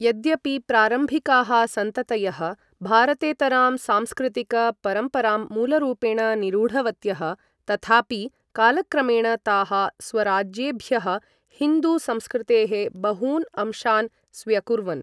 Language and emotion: Sanskrit, neutral